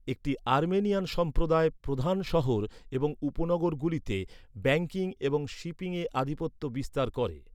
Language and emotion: Bengali, neutral